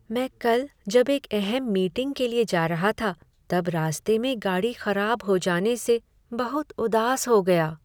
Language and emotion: Hindi, sad